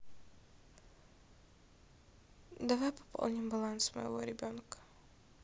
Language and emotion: Russian, neutral